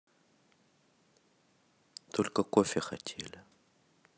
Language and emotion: Russian, neutral